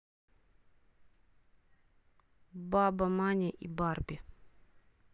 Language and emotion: Russian, neutral